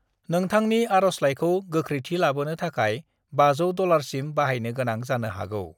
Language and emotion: Bodo, neutral